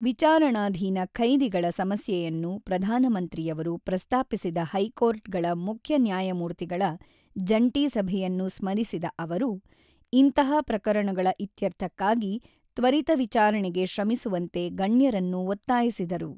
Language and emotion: Kannada, neutral